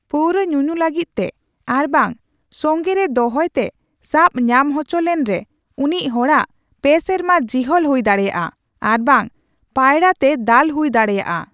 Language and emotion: Santali, neutral